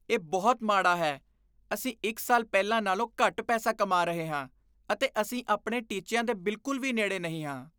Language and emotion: Punjabi, disgusted